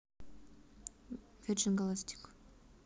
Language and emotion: Russian, neutral